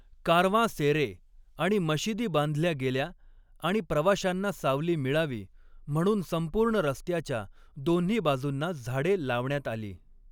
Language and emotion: Marathi, neutral